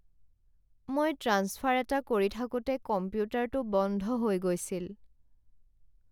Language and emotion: Assamese, sad